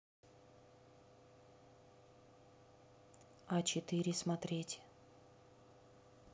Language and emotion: Russian, neutral